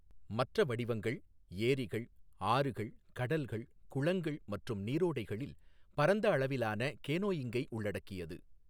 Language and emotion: Tamil, neutral